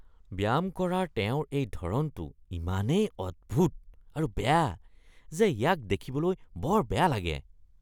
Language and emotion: Assamese, disgusted